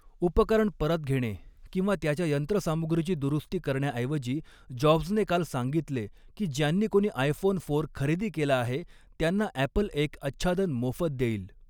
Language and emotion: Marathi, neutral